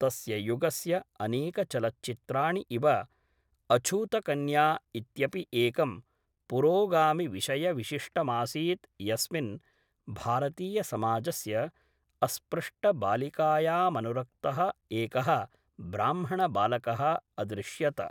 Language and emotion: Sanskrit, neutral